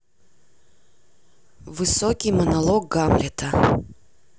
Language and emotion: Russian, neutral